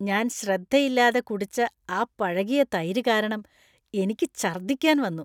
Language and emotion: Malayalam, disgusted